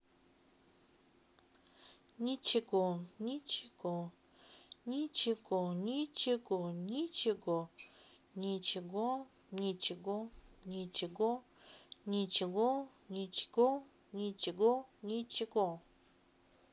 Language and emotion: Russian, neutral